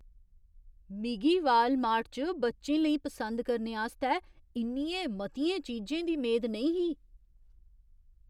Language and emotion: Dogri, surprised